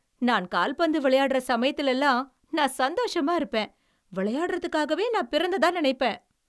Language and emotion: Tamil, happy